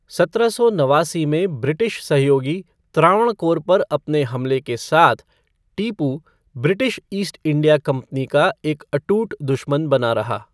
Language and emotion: Hindi, neutral